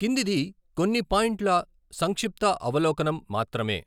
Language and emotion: Telugu, neutral